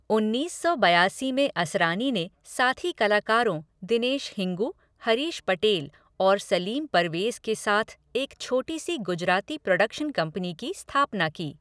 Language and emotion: Hindi, neutral